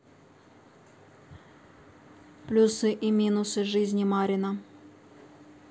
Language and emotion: Russian, neutral